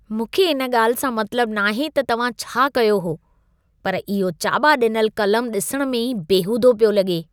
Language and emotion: Sindhi, disgusted